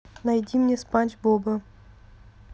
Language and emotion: Russian, neutral